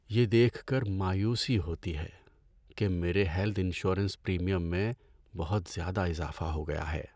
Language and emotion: Urdu, sad